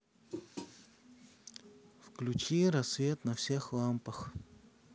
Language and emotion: Russian, sad